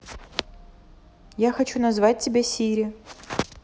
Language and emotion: Russian, neutral